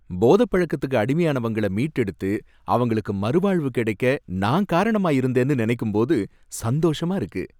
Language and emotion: Tamil, happy